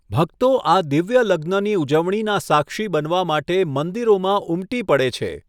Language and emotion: Gujarati, neutral